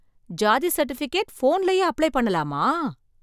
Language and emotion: Tamil, surprised